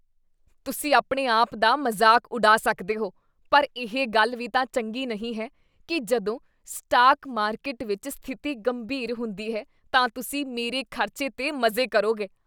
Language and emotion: Punjabi, disgusted